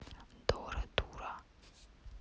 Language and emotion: Russian, neutral